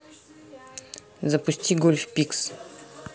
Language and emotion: Russian, neutral